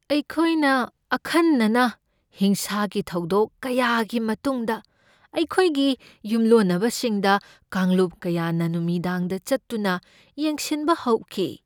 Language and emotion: Manipuri, fearful